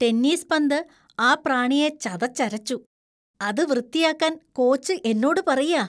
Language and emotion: Malayalam, disgusted